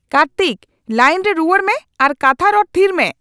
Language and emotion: Santali, angry